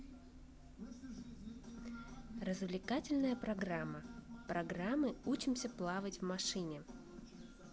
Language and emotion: Russian, positive